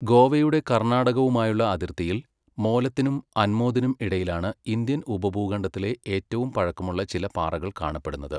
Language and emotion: Malayalam, neutral